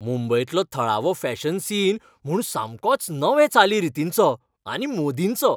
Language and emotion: Goan Konkani, happy